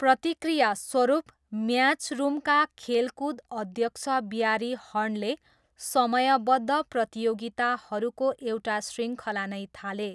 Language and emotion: Nepali, neutral